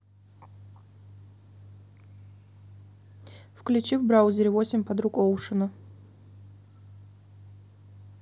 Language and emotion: Russian, neutral